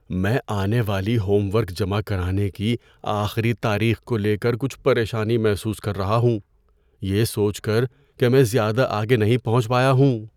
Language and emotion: Urdu, fearful